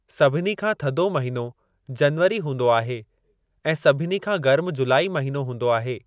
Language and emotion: Sindhi, neutral